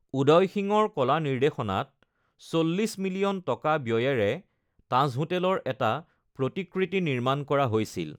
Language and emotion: Assamese, neutral